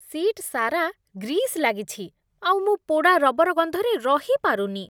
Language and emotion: Odia, disgusted